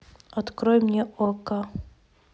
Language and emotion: Russian, neutral